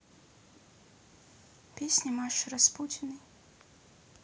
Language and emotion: Russian, neutral